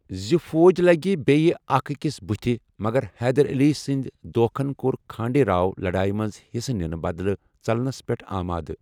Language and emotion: Kashmiri, neutral